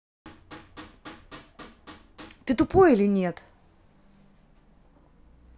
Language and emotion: Russian, angry